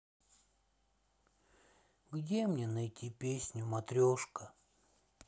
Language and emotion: Russian, sad